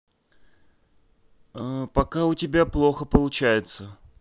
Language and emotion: Russian, neutral